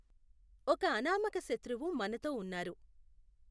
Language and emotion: Telugu, neutral